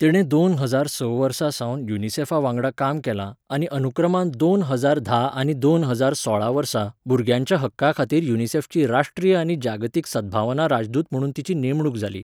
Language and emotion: Goan Konkani, neutral